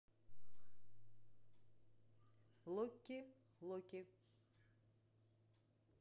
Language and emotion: Russian, neutral